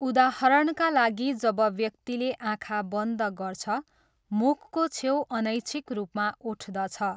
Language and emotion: Nepali, neutral